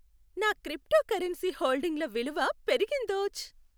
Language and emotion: Telugu, happy